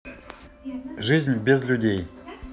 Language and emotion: Russian, neutral